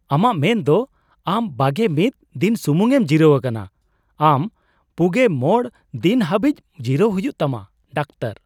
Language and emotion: Santali, surprised